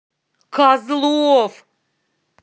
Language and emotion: Russian, angry